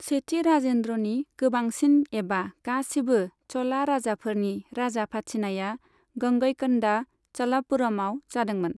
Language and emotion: Bodo, neutral